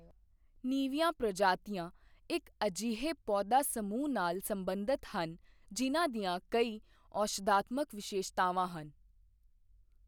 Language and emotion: Punjabi, neutral